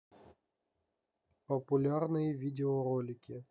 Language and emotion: Russian, neutral